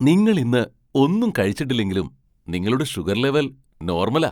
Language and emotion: Malayalam, surprised